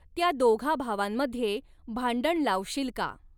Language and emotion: Marathi, neutral